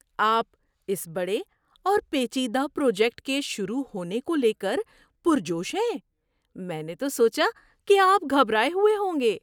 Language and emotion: Urdu, surprised